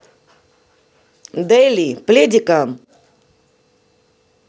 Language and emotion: Russian, neutral